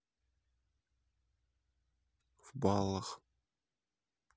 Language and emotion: Russian, neutral